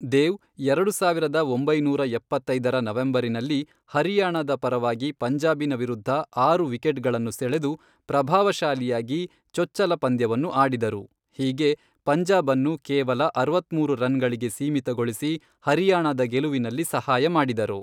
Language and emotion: Kannada, neutral